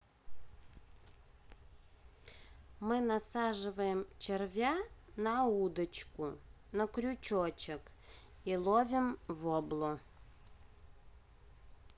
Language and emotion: Russian, neutral